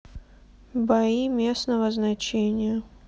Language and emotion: Russian, sad